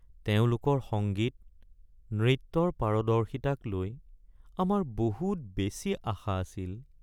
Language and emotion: Assamese, sad